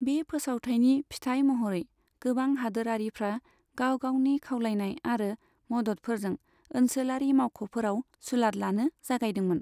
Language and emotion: Bodo, neutral